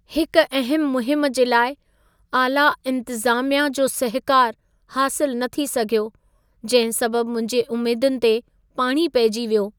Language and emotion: Sindhi, sad